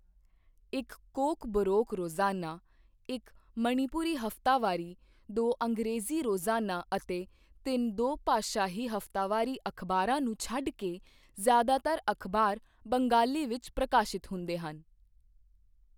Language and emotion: Punjabi, neutral